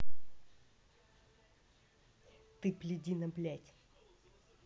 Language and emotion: Russian, angry